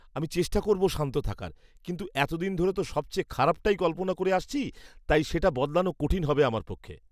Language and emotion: Bengali, disgusted